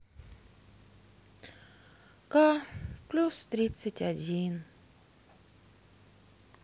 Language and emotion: Russian, sad